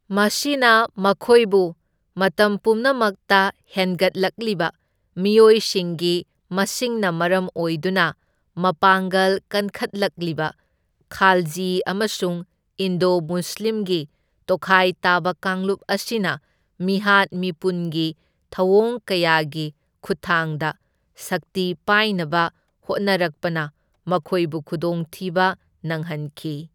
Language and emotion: Manipuri, neutral